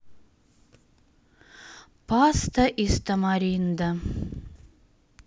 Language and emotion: Russian, sad